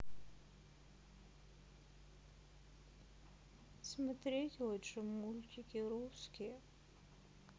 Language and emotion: Russian, sad